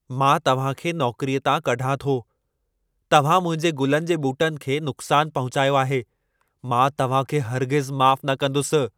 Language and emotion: Sindhi, angry